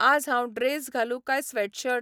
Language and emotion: Goan Konkani, neutral